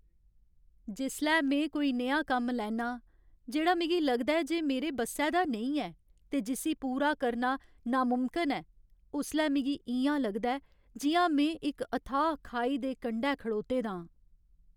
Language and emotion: Dogri, sad